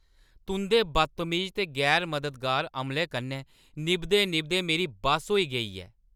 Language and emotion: Dogri, angry